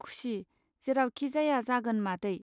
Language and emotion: Bodo, neutral